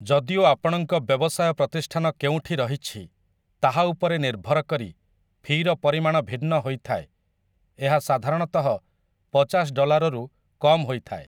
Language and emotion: Odia, neutral